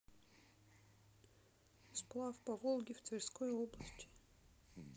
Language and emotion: Russian, sad